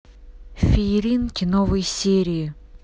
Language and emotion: Russian, neutral